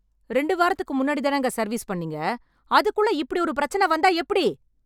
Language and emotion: Tamil, angry